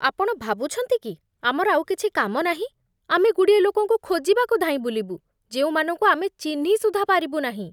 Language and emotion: Odia, disgusted